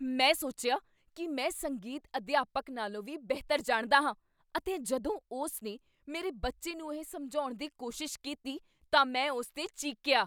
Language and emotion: Punjabi, angry